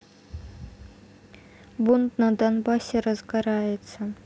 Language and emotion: Russian, neutral